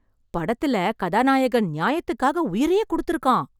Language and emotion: Tamil, happy